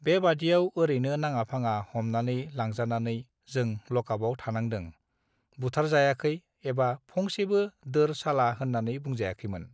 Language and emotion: Bodo, neutral